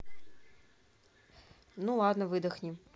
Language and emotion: Russian, neutral